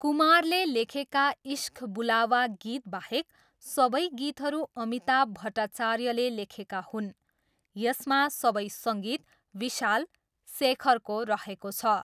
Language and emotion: Nepali, neutral